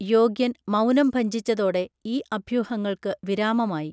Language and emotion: Malayalam, neutral